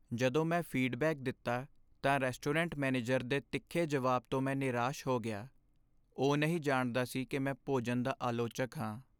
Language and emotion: Punjabi, sad